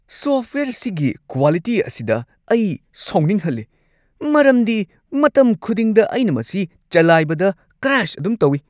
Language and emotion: Manipuri, disgusted